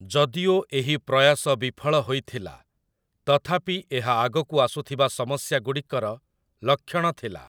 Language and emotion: Odia, neutral